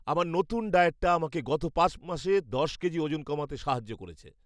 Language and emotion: Bengali, happy